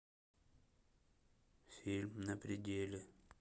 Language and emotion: Russian, neutral